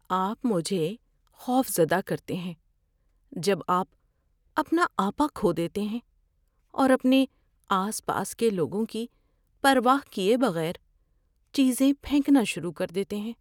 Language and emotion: Urdu, fearful